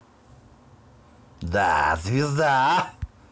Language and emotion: Russian, positive